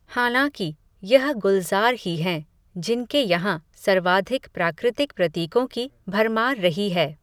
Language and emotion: Hindi, neutral